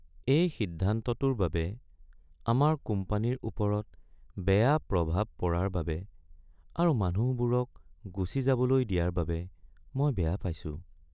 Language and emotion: Assamese, sad